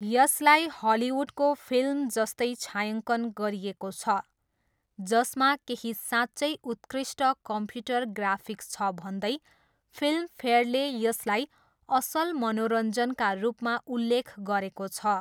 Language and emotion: Nepali, neutral